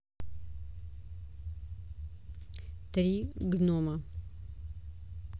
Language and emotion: Russian, neutral